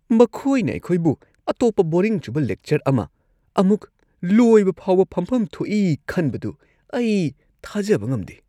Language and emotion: Manipuri, disgusted